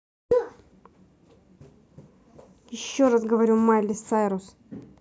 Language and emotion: Russian, angry